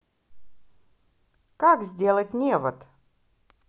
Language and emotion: Russian, positive